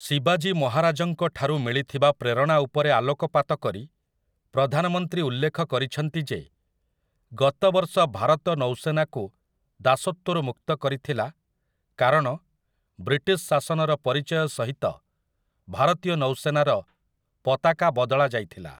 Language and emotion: Odia, neutral